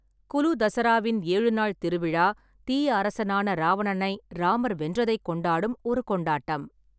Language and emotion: Tamil, neutral